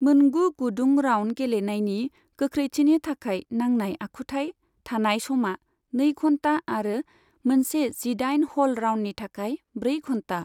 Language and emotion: Bodo, neutral